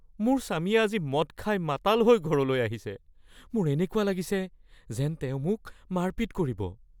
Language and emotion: Assamese, fearful